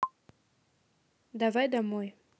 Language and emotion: Russian, neutral